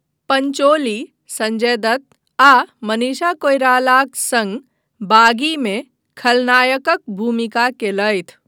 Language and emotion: Maithili, neutral